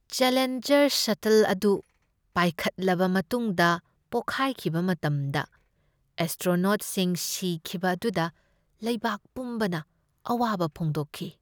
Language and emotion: Manipuri, sad